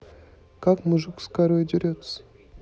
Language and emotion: Russian, neutral